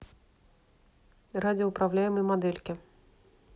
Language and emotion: Russian, neutral